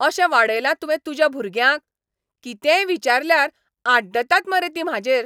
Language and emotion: Goan Konkani, angry